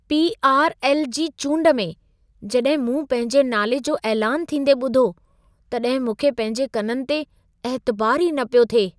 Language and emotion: Sindhi, surprised